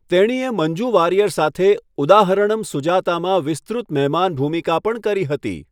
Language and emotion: Gujarati, neutral